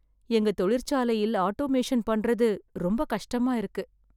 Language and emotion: Tamil, sad